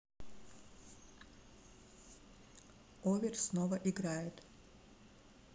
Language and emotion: Russian, neutral